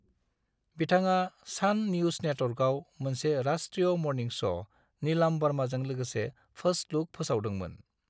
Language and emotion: Bodo, neutral